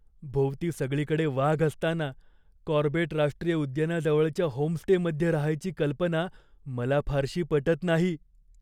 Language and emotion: Marathi, fearful